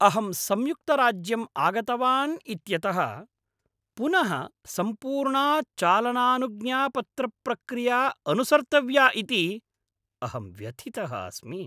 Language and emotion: Sanskrit, angry